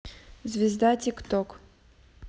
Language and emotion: Russian, neutral